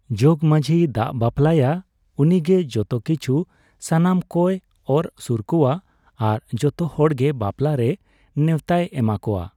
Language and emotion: Santali, neutral